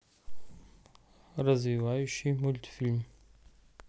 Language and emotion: Russian, neutral